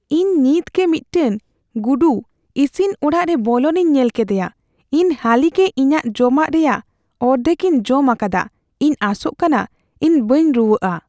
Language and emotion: Santali, fearful